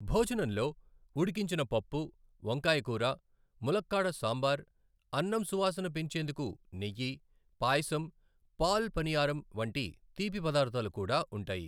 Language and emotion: Telugu, neutral